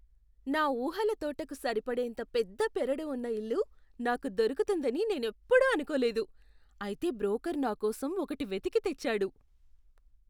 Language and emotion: Telugu, surprised